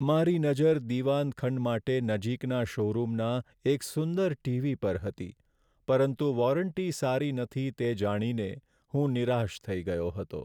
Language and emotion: Gujarati, sad